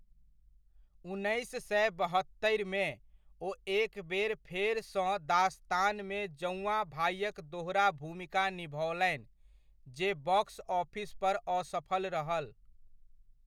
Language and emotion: Maithili, neutral